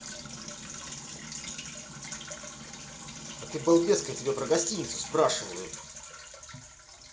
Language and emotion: Russian, angry